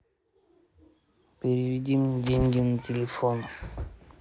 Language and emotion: Russian, neutral